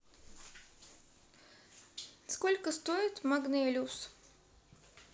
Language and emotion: Russian, neutral